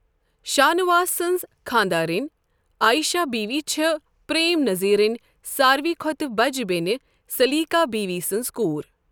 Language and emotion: Kashmiri, neutral